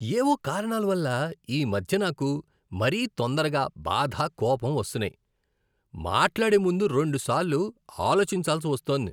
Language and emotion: Telugu, disgusted